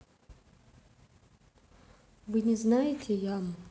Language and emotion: Russian, neutral